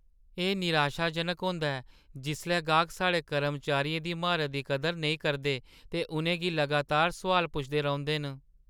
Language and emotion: Dogri, sad